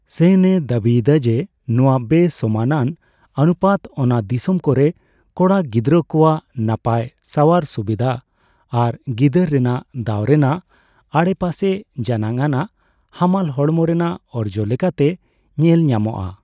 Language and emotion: Santali, neutral